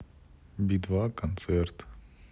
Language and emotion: Russian, neutral